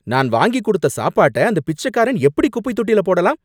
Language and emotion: Tamil, angry